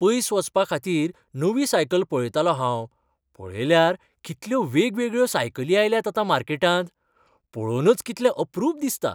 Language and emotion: Goan Konkani, happy